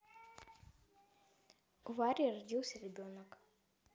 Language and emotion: Russian, neutral